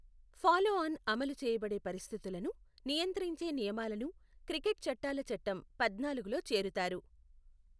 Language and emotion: Telugu, neutral